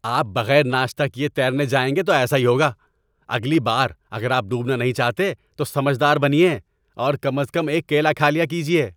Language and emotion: Urdu, angry